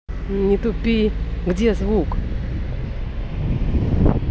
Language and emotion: Russian, angry